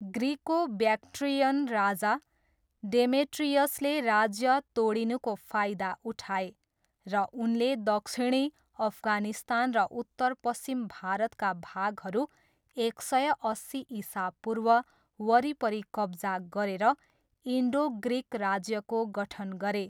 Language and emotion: Nepali, neutral